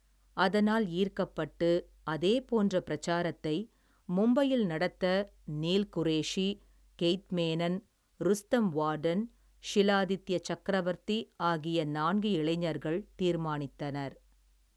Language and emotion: Tamil, neutral